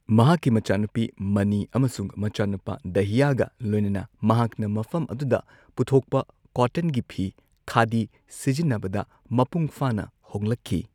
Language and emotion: Manipuri, neutral